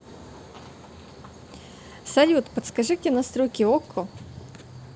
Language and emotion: Russian, positive